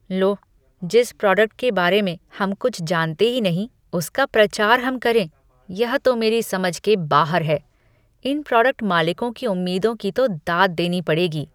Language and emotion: Hindi, disgusted